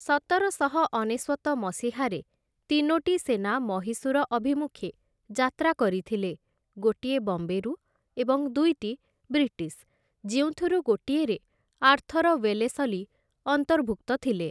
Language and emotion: Odia, neutral